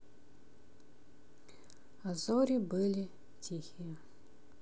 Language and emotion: Russian, sad